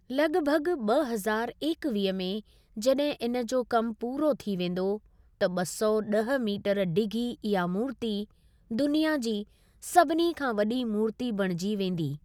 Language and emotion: Sindhi, neutral